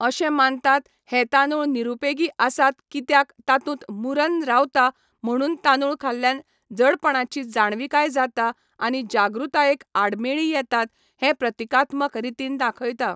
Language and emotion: Goan Konkani, neutral